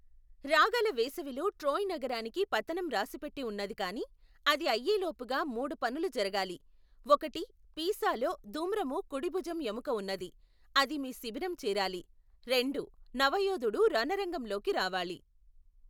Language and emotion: Telugu, neutral